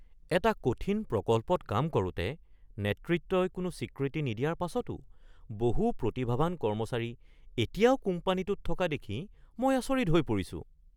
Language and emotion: Assamese, surprised